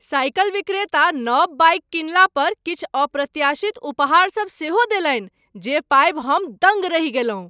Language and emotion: Maithili, surprised